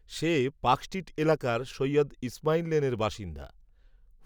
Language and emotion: Bengali, neutral